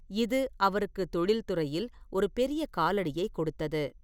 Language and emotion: Tamil, neutral